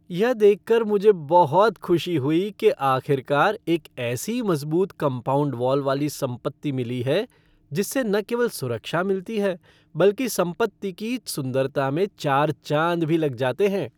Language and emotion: Hindi, happy